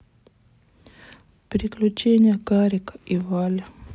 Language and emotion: Russian, sad